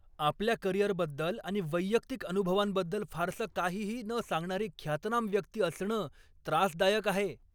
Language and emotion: Marathi, angry